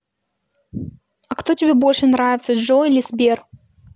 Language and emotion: Russian, neutral